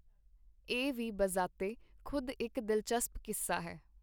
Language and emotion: Punjabi, neutral